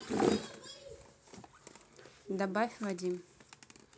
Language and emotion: Russian, neutral